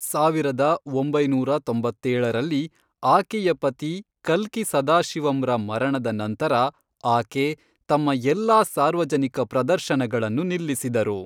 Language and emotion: Kannada, neutral